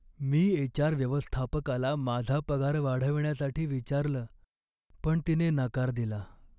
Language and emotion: Marathi, sad